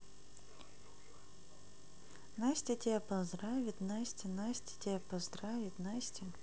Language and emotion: Russian, neutral